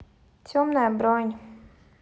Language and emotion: Russian, sad